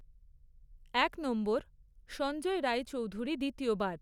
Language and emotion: Bengali, neutral